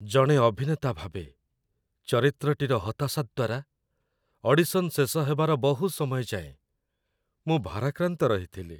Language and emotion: Odia, sad